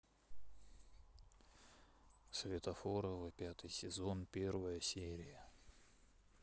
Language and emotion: Russian, neutral